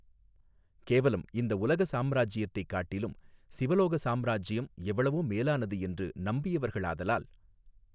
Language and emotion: Tamil, neutral